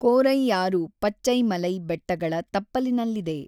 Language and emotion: Kannada, neutral